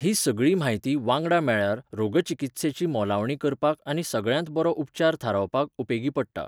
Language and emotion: Goan Konkani, neutral